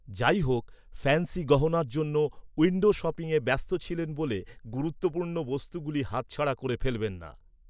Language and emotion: Bengali, neutral